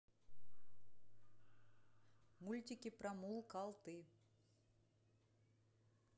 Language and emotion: Russian, neutral